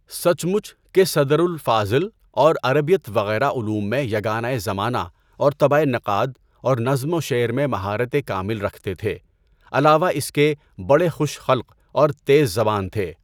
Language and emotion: Urdu, neutral